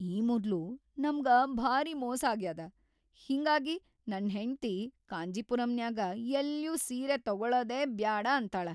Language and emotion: Kannada, fearful